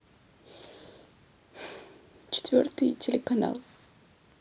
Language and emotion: Russian, sad